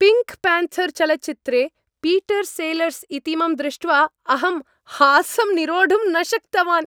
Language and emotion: Sanskrit, happy